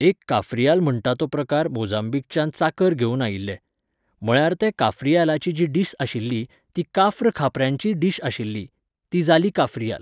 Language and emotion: Goan Konkani, neutral